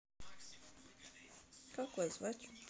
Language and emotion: Russian, neutral